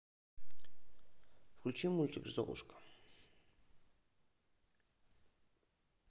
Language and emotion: Russian, neutral